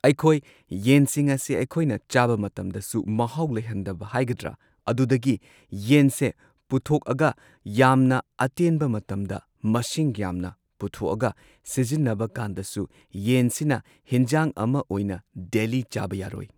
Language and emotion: Manipuri, neutral